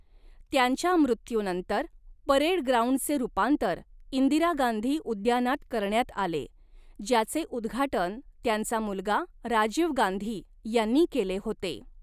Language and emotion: Marathi, neutral